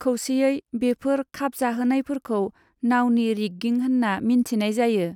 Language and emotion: Bodo, neutral